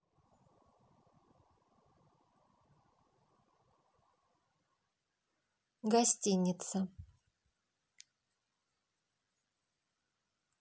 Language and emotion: Russian, neutral